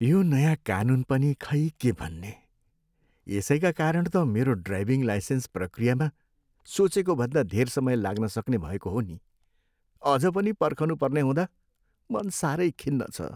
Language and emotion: Nepali, sad